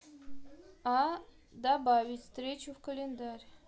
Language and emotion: Russian, neutral